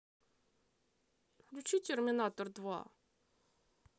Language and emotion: Russian, neutral